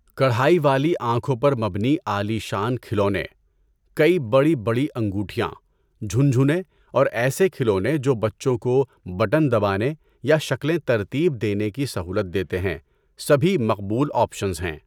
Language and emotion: Urdu, neutral